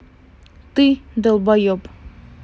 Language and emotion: Russian, angry